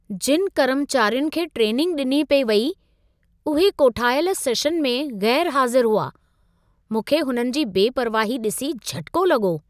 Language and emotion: Sindhi, surprised